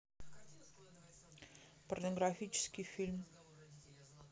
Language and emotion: Russian, neutral